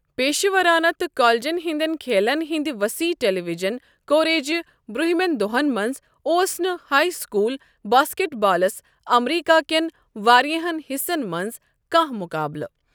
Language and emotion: Kashmiri, neutral